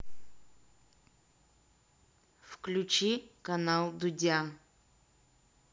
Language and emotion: Russian, neutral